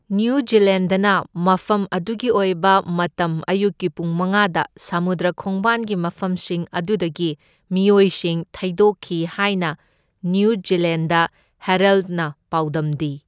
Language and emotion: Manipuri, neutral